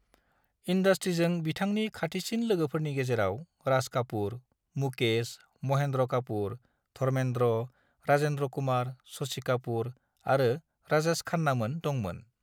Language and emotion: Bodo, neutral